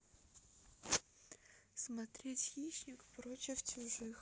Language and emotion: Russian, neutral